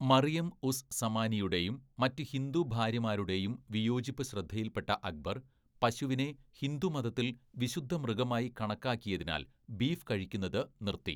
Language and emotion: Malayalam, neutral